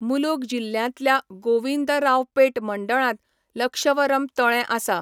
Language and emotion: Goan Konkani, neutral